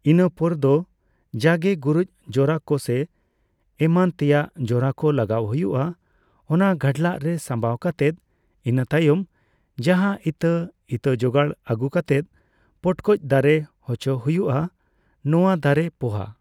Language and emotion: Santali, neutral